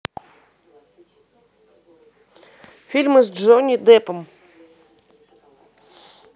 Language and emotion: Russian, positive